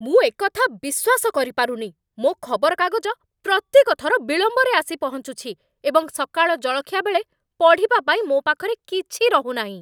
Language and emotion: Odia, angry